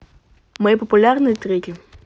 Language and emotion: Russian, neutral